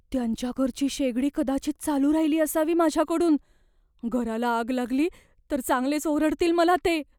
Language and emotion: Marathi, fearful